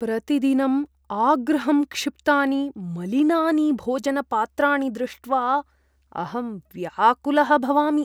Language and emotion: Sanskrit, disgusted